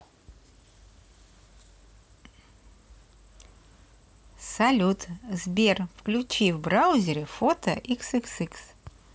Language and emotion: Russian, positive